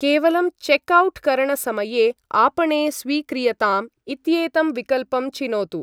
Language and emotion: Sanskrit, neutral